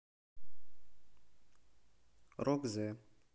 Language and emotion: Russian, neutral